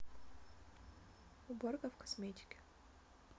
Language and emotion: Russian, neutral